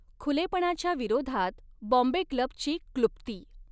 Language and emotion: Marathi, neutral